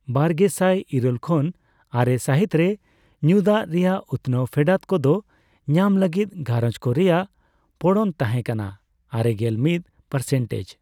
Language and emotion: Santali, neutral